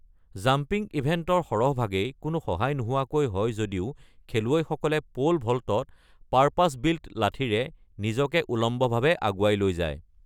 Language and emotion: Assamese, neutral